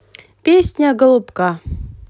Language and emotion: Russian, positive